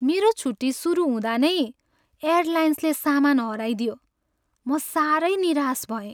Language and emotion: Nepali, sad